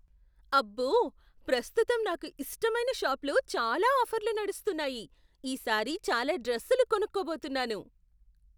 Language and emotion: Telugu, surprised